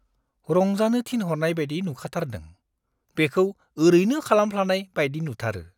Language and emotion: Bodo, disgusted